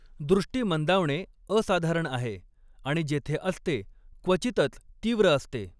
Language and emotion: Marathi, neutral